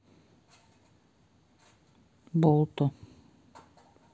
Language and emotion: Russian, neutral